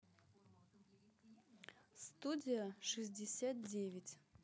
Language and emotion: Russian, neutral